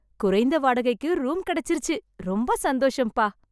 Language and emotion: Tamil, happy